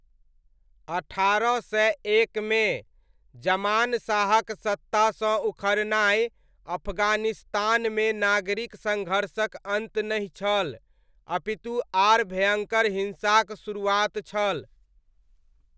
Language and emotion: Maithili, neutral